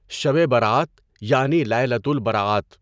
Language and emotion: Urdu, neutral